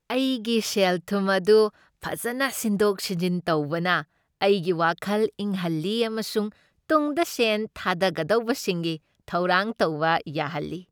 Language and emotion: Manipuri, happy